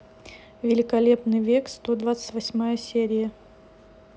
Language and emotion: Russian, neutral